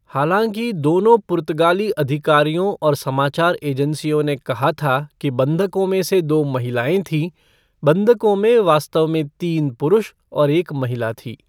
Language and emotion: Hindi, neutral